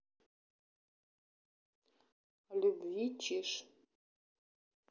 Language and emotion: Russian, neutral